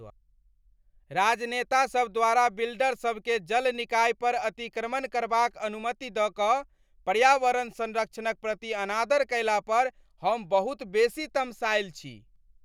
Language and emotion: Maithili, angry